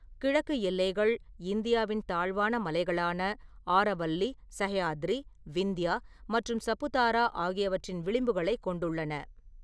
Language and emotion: Tamil, neutral